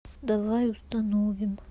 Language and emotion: Russian, sad